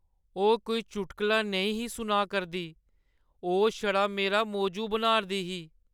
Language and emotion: Dogri, sad